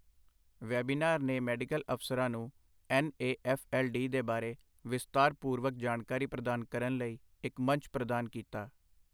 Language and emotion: Punjabi, neutral